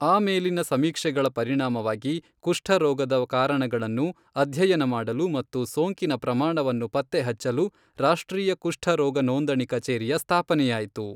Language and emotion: Kannada, neutral